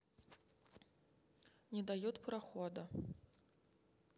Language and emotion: Russian, neutral